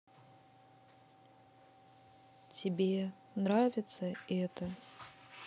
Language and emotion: Russian, neutral